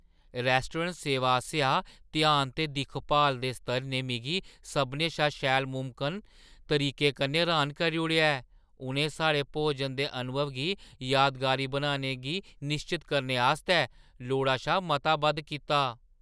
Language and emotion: Dogri, surprised